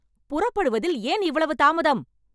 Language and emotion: Tamil, angry